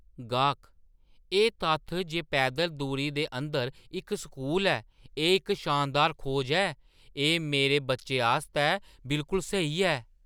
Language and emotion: Dogri, surprised